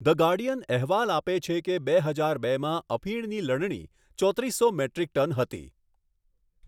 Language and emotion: Gujarati, neutral